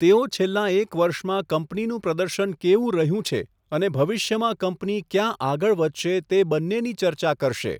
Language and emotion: Gujarati, neutral